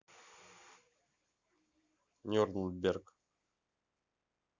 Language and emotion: Russian, neutral